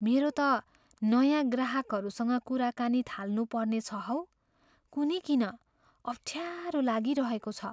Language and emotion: Nepali, fearful